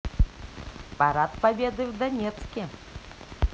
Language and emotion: Russian, positive